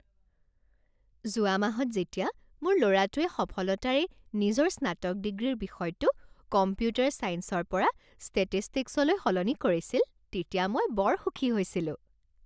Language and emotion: Assamese, happy